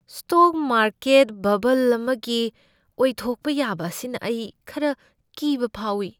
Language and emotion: Manipuri, fearful